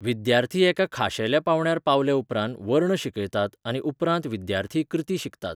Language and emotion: Goan Konkani, neutral